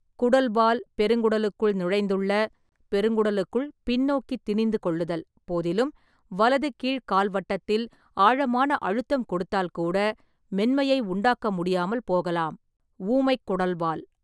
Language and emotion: Tamil, neutral